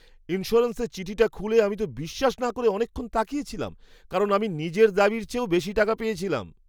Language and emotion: Bengali, surprised